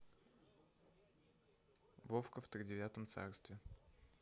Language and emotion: Russian, neutral